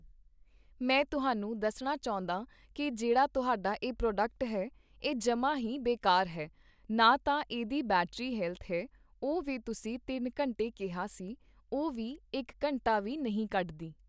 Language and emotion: Punjabi, neutral